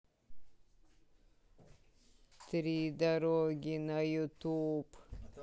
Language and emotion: Russian, neutral